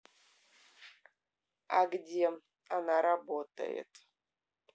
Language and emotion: Russian, neutral